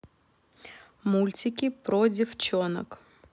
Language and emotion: Russian, neutral